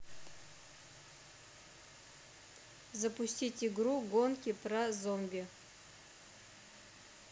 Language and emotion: Russian, neutral